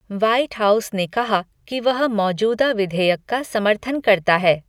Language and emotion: Hindi, neutral